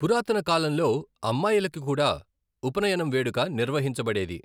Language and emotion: Telugu, neutral